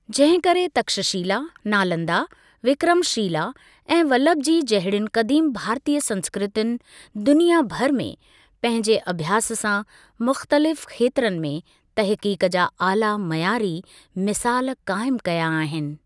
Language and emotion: Sindhi, neutral